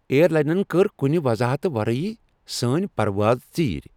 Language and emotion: Kashmiri, angry